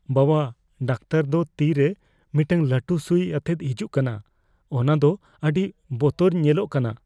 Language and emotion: Santali, fearful